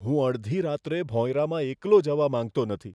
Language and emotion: Gujarati, fearful